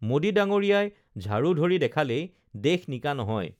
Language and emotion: Assamese, neutral